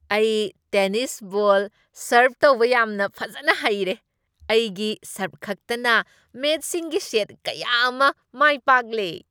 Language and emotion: Manipuri, happy